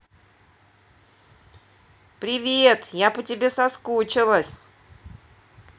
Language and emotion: Russian, positive